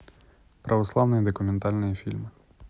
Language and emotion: Russian, neutral